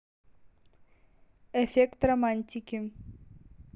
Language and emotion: Russian, neutral